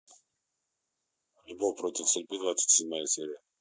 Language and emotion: Russian, neutral